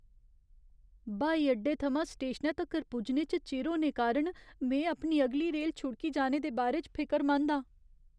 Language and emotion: Dogri, fearful